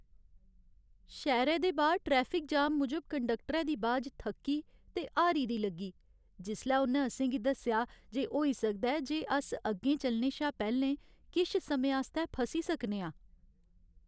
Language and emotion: Dogri, sad